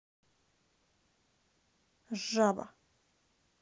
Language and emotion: Russian, angry